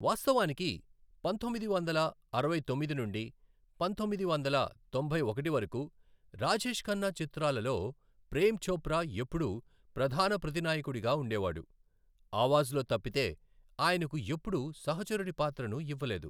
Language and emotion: Telugu, neutral